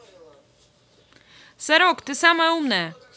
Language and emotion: Russian, positive